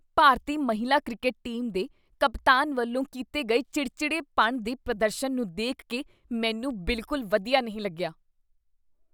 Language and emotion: Punjabi, disgusted